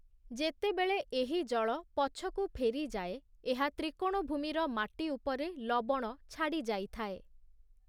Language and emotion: Odia, neutral